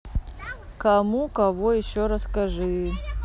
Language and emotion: Russian, neutral